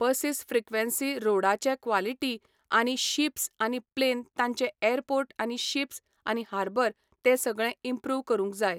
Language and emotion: Goan Konkani, neutral